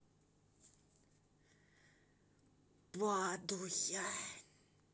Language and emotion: Russian, neutral